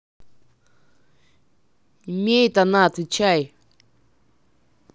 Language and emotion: Russian, angry